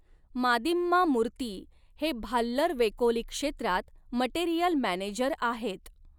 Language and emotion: Marathi, neutral